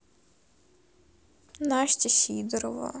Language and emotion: Russian, sad